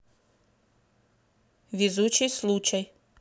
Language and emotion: Russian, neutral